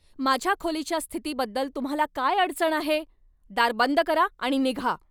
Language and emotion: Marathi, angry